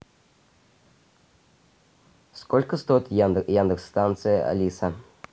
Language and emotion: Russian, neutral